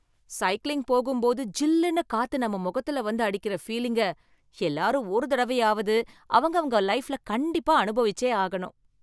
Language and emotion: Tamil, happy